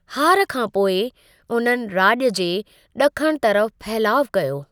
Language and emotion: Sindhi, neutral